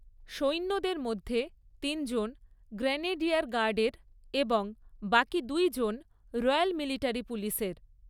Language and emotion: Bengali, neutral